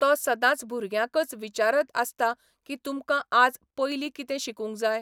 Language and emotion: Goan Konkani, neutral